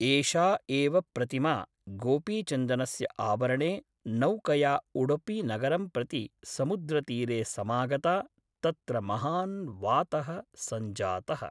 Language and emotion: Sanskrit, neutral